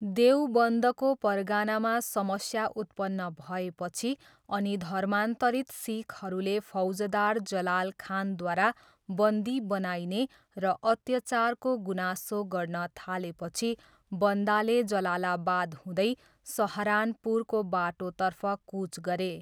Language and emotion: Nepali, neutral